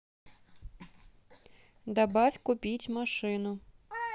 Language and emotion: Russian, neutral